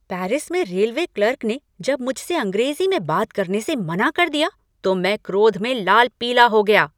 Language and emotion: Hindi, angry